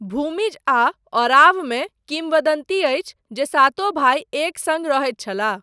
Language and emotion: Maithili, neutral